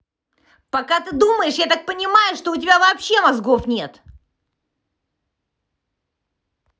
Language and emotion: Russian, angry